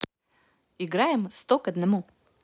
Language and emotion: Russian, positive